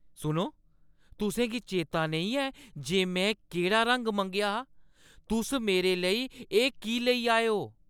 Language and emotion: Dogri, angry